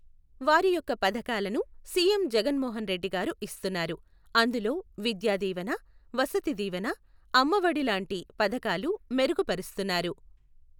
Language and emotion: Telugu, neutral